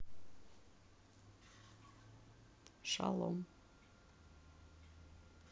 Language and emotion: Russian, neutral